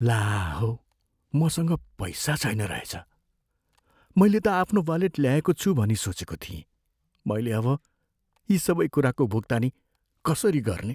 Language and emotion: Nepali, fearful